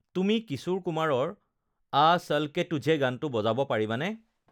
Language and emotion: Assamese, neutral